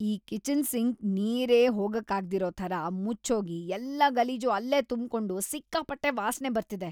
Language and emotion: Kannada, disgusted